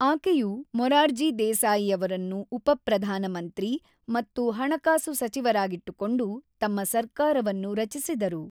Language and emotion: Kannada, neutral